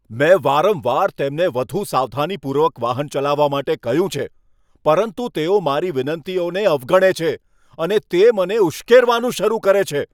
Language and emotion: Gujarati, angry